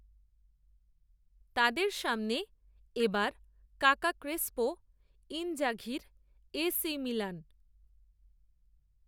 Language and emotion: Bengali, neutral